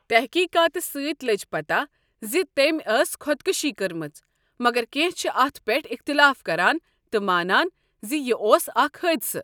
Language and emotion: Kashmiri, neutral